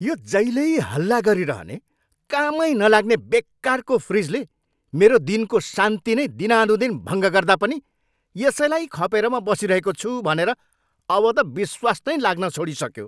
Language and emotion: Nepali, angry